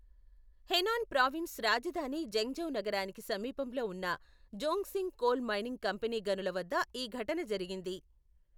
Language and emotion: Telugu, neutral